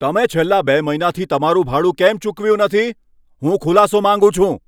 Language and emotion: Gujarati, angry